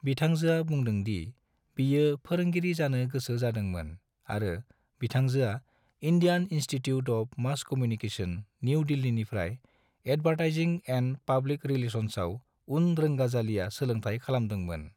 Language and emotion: Bodo, neutral